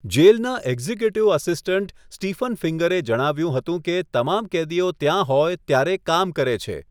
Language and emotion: Gujarati, neutral